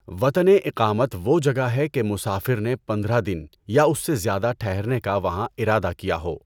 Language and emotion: Urdu, neutral